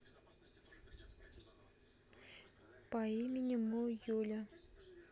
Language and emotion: Russian, neutral